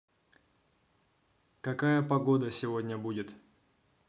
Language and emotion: Russian, neutral